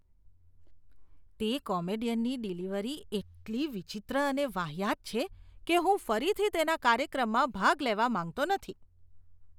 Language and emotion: Gujarati, disgusted